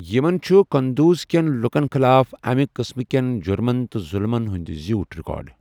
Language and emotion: Kashmiri, neutral